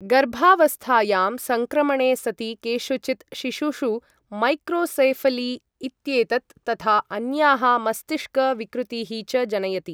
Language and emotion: Sanskrit, neutral